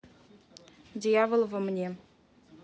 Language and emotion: Russian, neutral